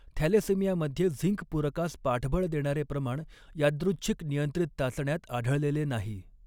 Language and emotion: Marathi, neutral